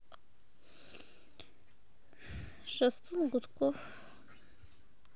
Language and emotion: Russian, sad